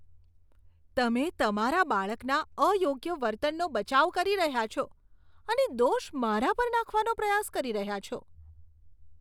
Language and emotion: Gujarati, disgusted